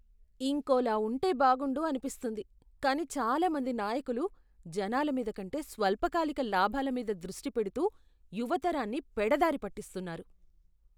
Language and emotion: Telugu, disgusted